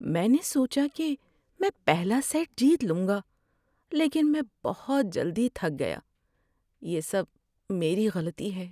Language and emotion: Urdu, sad